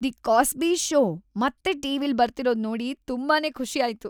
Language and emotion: Kannada, happy